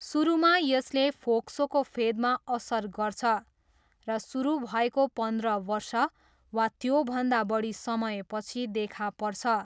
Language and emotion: Nepali, neutral